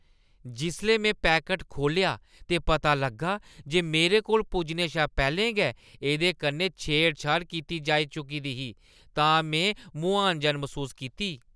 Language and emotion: Dogri, disgusted